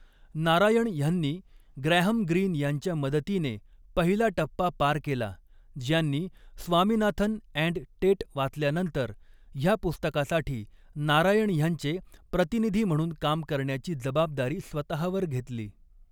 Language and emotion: Marathi, neutral